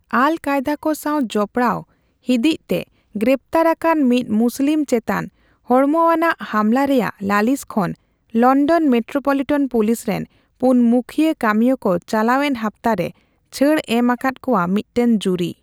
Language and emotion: Santali, neutral